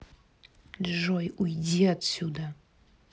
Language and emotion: Russian, angry